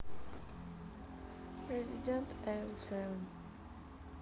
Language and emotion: Russian, sad